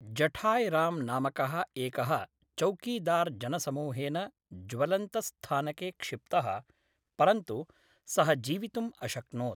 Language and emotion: Sanskrit, neutral